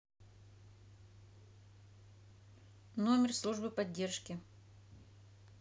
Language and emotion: Russian, neutral